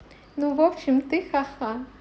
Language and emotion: Russian, positive